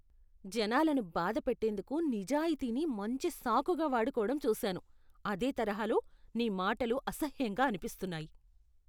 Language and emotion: Telugu, disgusted